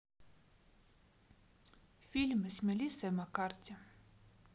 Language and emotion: Russian, neutral